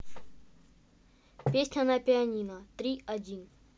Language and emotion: Russian, neutral